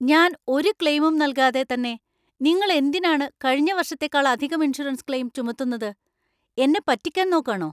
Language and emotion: Malayalam, angry